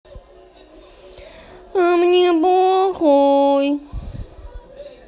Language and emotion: Russian, neutral